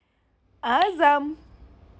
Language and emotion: Russian, positive